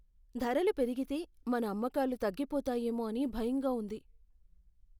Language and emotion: Telugu, fearful